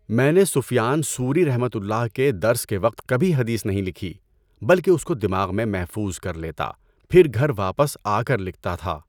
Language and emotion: Urdu, neutral